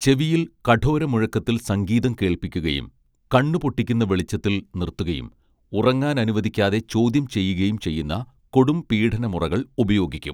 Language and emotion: Malayalam, neutral